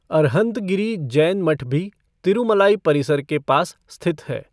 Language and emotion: Hindi, neutral